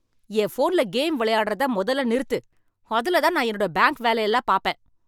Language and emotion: Tamil, angry